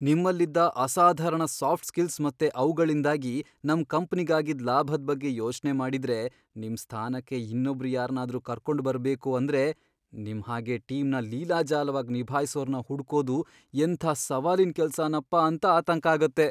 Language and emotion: Kannada, fearful